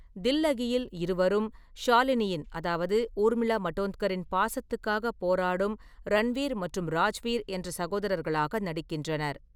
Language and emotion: Tamil, neutral